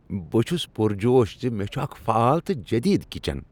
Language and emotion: Kashmiri, happy